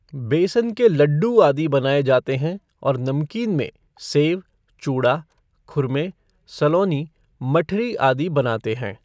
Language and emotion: Hindi, neutral